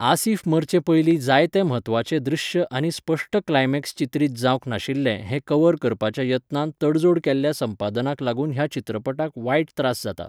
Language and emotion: Goan Konkani, neutral